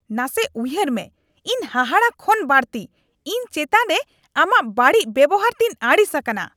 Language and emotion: Santali, angry